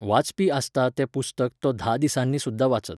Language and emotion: Goan Konkani, neutral